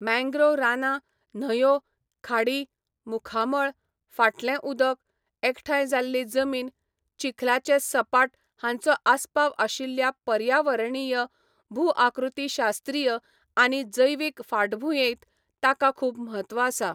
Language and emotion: Goan Konkani, neutral